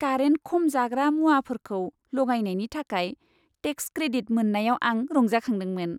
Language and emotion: Bodo, happy